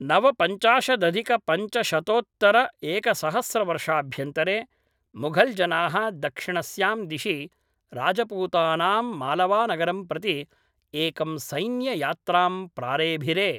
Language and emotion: Sanskrit, neutral